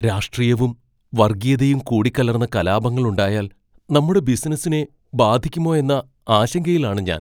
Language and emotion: Malayalam, fearful